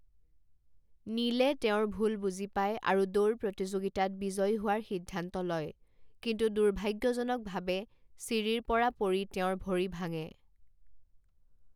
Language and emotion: Assamese, neutral